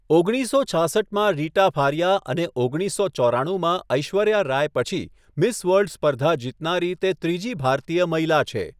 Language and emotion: Gujarati, neutral